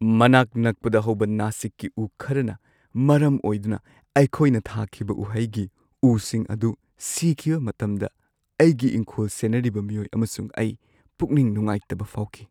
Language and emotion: Manipuri, sad